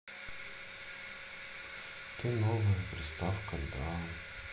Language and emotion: Russian, sad